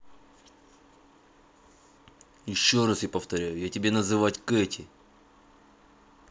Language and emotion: Russian, angry